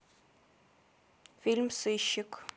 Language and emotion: Russian, neutral